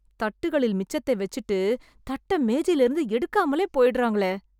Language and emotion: Tamil, disgusted